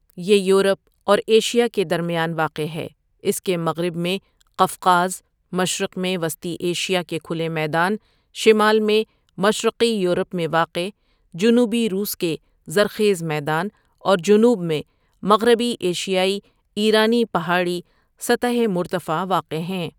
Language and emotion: Urdu, neutral